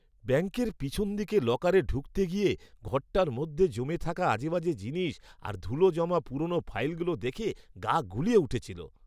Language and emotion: Bengali, disgusted